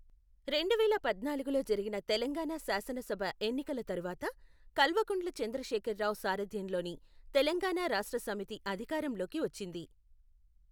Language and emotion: Telugu, neutral